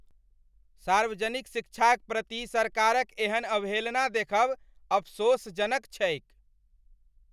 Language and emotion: Maithili, angry